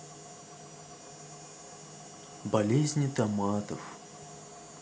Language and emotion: Russian, sad